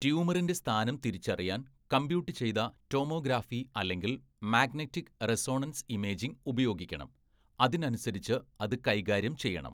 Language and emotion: Malayalam, neutral